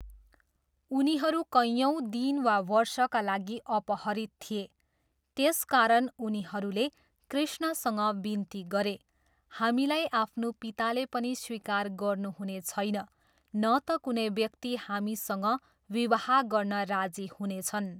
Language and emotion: Nepali, neutral